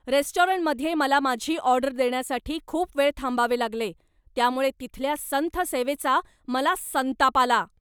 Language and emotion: Marathi, angry